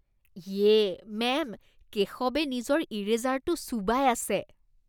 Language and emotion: Assamese, disgusted